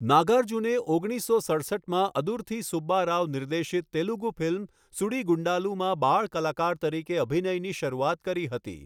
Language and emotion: Gujarati, neutral